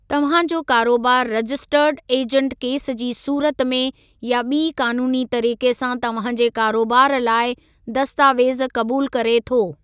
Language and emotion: Sindhi, neutral